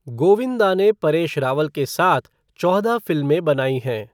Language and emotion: Hindi, neutral